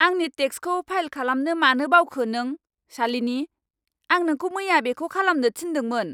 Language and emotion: Bodo, angry